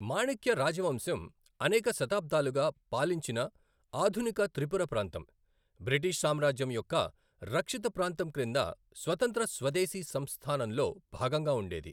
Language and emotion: Telugu, neutral